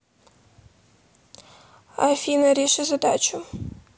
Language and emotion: Russian, neutral